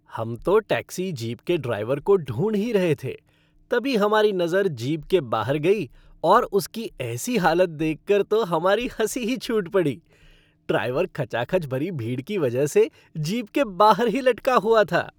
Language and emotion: Hindi, happy